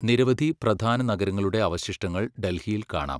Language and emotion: Malayalam, neutral